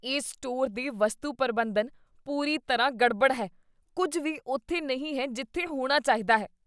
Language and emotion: Punjabi, disgusted